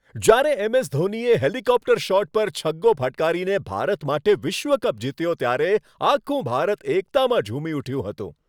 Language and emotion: Gujarati, happy